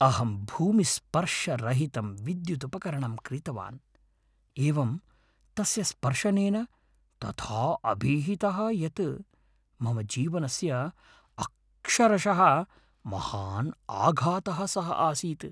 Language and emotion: Sanskrit, fearful